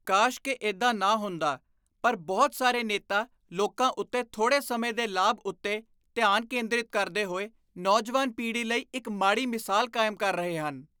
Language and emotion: Punjabi, disgusted